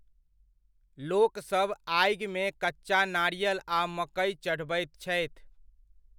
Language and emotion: Maithili, neutral